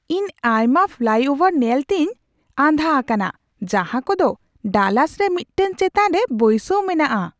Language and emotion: Santali, surprised